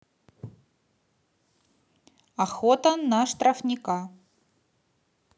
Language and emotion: Russian, neutral